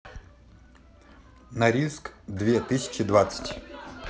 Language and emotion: Russian, neutral